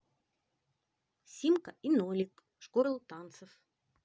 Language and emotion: Russian, positive